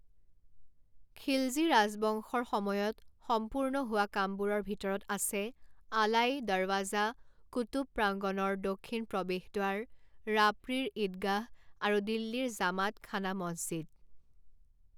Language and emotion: Assamese, neutral